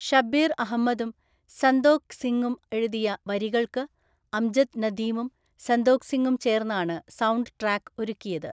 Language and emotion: Malayalam, neutral